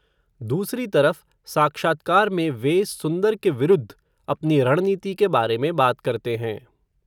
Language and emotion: Hindi, neutral